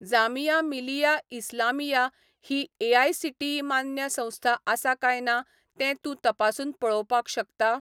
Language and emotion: Goan Konkani, neutral